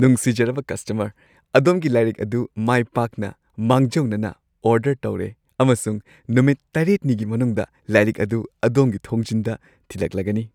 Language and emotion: Manipuri, happy